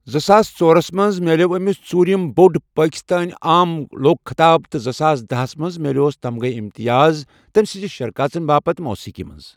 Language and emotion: Kashmiri, neutral